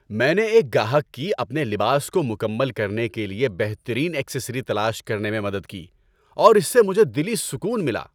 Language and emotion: Urdu, happy